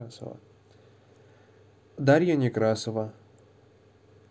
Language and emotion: Russian, neutral